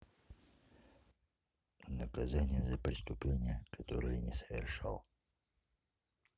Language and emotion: Russian, neutral